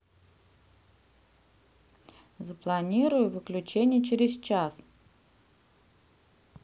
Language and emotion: Russian, neutral